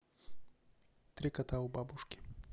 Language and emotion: Russian, neutral